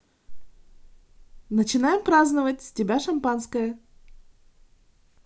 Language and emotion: Russian, positive